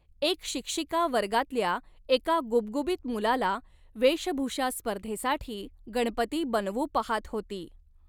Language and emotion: Marathi, neutral